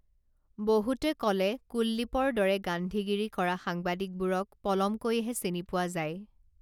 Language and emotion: Assamese, neutral